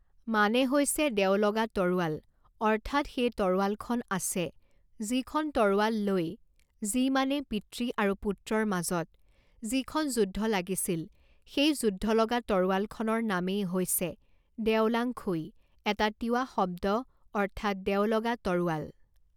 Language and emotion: Assamese, neutral